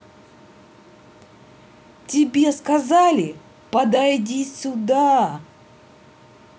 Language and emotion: Russian, angry